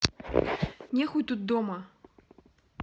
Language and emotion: Russian, neutral